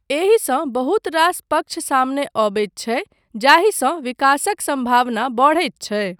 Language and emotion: Maithili, neutral